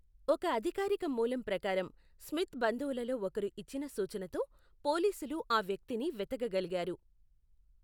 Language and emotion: Telugu, neutral